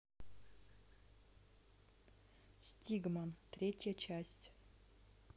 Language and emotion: Russian, neutral